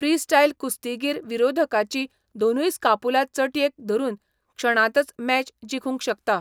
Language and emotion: Goan Konkani, neutral